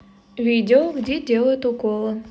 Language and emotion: Russian, neutral